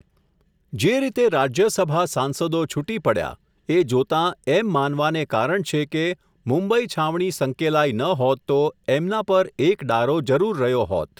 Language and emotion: Gujarati, neutral